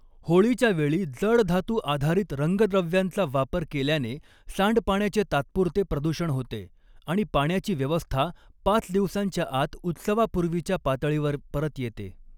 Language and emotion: Marathi, neutral